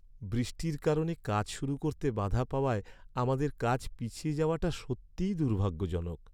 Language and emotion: Bengali, sad